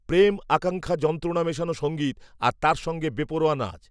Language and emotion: Bengali, neutral